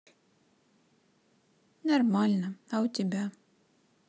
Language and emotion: Russian, sad